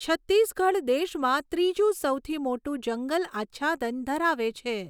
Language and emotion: Gujarati, neutral